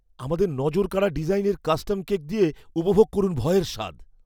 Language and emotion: Bengali, fearful